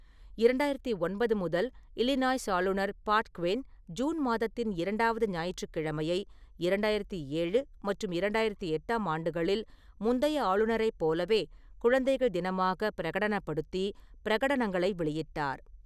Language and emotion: Tamil, neutral